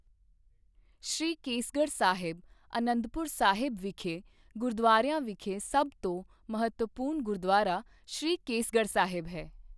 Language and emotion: Punjabi, neutral